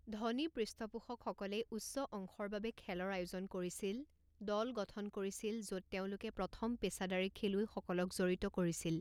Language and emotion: Assamese, neutral